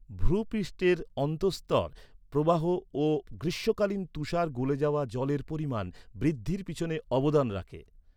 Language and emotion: Bengali, neutral